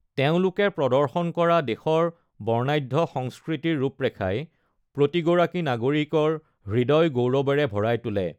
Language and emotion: Assamese, neutral